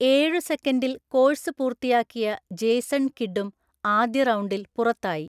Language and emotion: Malayalam, neutral